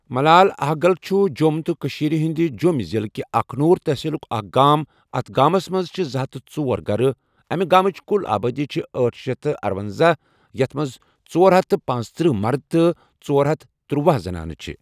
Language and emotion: Kashmiri, neutral